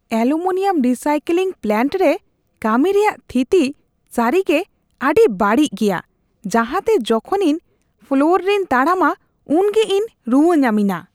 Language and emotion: Santali, disgusted